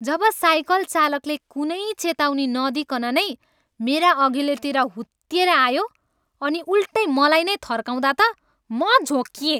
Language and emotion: Nepali, angry